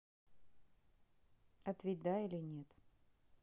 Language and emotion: Russian, neutral